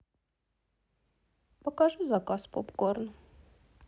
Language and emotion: Russian, sad